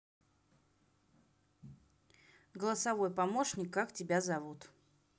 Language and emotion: Russian, neutral